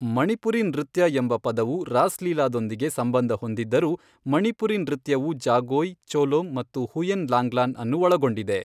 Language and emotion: Kannada, neutral